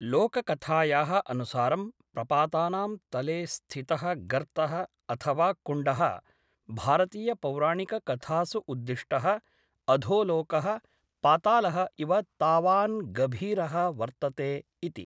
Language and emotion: Sanskrit, neutral